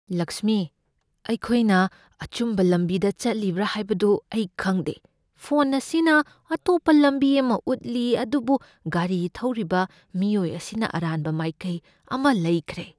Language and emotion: Manipuri, fearful